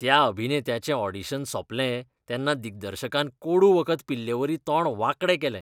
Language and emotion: Goan Konkani, disgusted